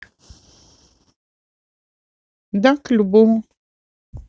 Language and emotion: Russian, neutral